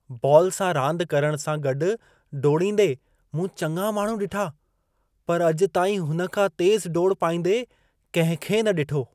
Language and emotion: Sindhi, surprised